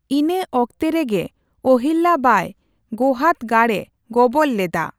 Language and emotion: Santali, neutral